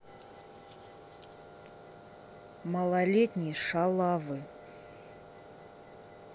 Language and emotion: Russian, neutral